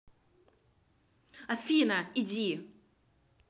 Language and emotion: Russian, angry